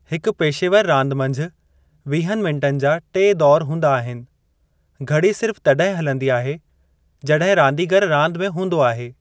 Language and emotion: Sindhi, neutral